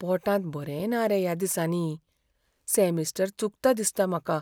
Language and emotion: Goan Konkani, fearful